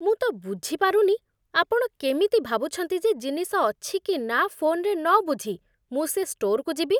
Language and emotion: Odia, disgusted